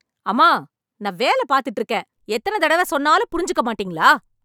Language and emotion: Tamil, angry